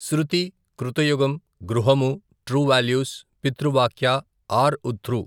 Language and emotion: Telugu, neutral